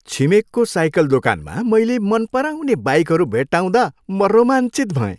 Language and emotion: Nepali, happy